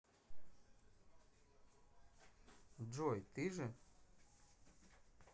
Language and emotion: Russian, neutral